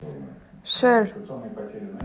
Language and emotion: Russian, neutral